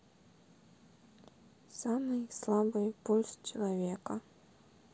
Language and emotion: Russian, neutral